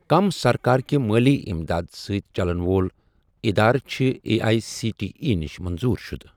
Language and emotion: Kashmiri, neutral